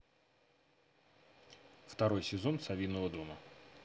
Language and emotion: Russian, neutral